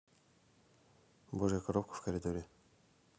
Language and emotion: Russian, neutral